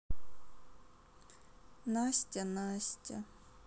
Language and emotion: Russian, sad